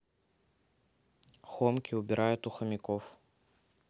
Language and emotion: Russian, neutral